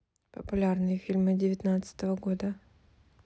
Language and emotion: Russian, neutral